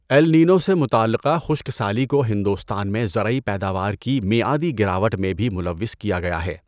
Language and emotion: Urdu, neutral